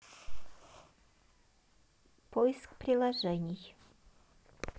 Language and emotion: Russian, neutral